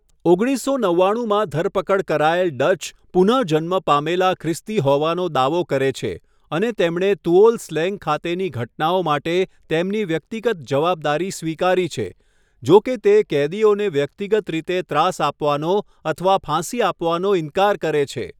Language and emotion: Gujarati, neutral